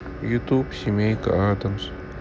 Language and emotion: Russian, sad